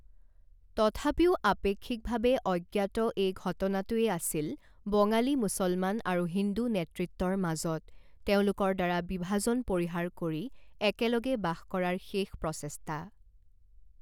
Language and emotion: Assamese, neutral